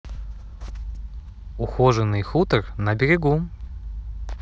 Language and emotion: Russian, neutral